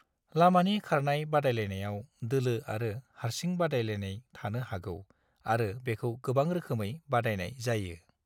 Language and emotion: Bodo, neutral